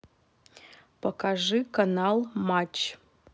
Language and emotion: Russian, neutral